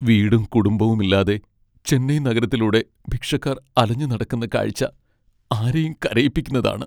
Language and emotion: Malayalam, sad